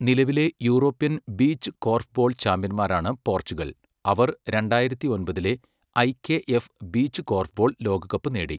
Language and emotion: Malayalam, neutral